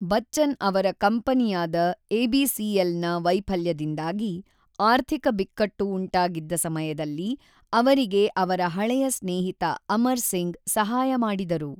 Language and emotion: Kannada, neutral